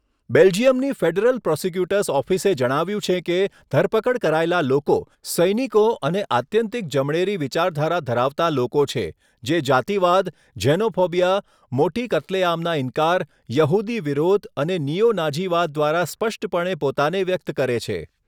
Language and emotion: Gujarati, neutral